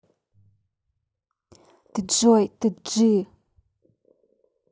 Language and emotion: Russian, angry